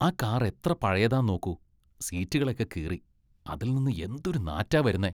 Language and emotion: Malayalam, disgusted